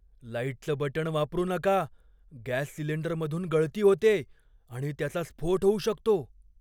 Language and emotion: Marathi, fearful